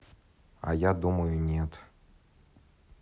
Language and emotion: Russian, neutral